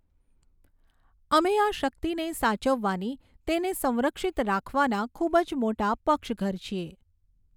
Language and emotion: Gujarati, neutral